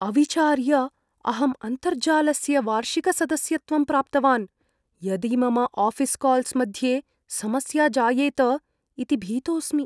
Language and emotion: Sanskrit, fearful